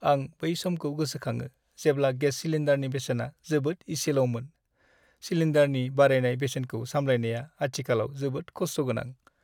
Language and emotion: Bodo, sad